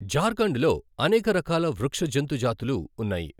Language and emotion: Telugu, neutral